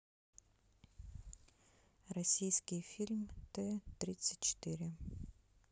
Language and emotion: Russian, neutral